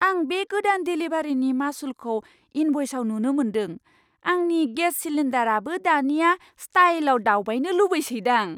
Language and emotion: Bodo, surprised